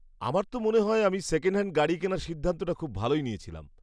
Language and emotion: Bengali, happy